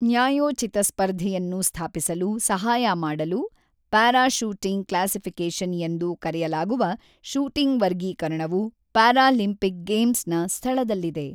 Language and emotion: Kannada, neutral